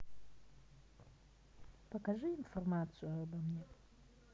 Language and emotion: Russian, neutral